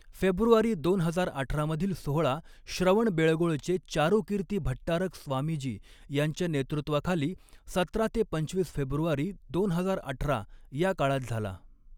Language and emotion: Marathi, neutral